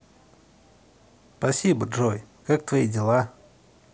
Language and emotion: Russian, neutral